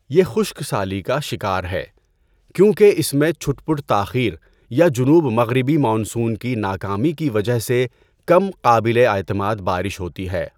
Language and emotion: Urdu, neutral